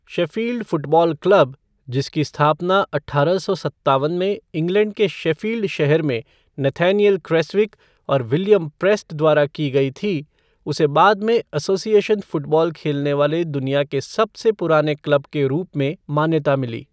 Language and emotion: Hindi, neutral